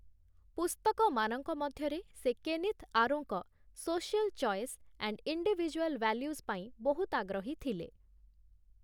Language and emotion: Odia, neutral